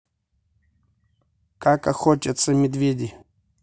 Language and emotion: Russian, neutral